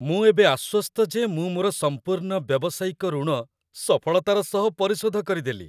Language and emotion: Odia, happy